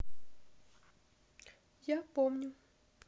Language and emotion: Russian, neutral